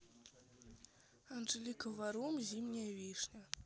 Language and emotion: Russian, neutral